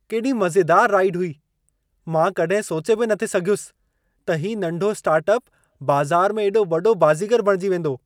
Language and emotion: Sindhi, surprised